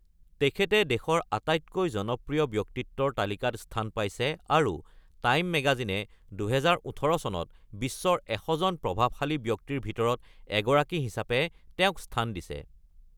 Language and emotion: Assamese, neutral